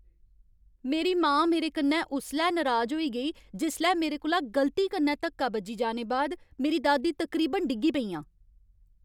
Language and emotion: Dogri, angry